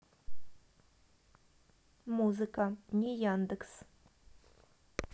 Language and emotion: Russian, neutral